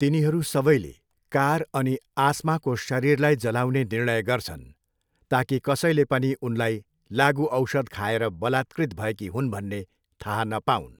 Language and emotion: Nepali, neutral